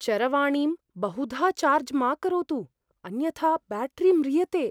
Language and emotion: Sanskrit, fearful